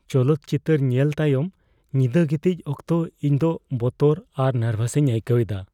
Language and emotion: Santali, fearful